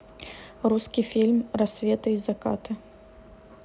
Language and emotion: Russian, neutral